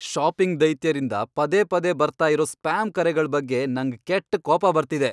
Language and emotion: Kannada, angry